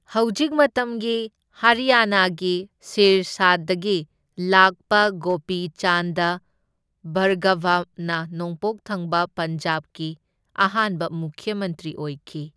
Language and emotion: Manipuri, neutral